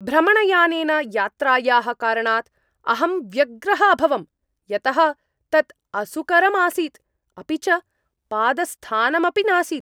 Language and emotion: Sanskrit, angry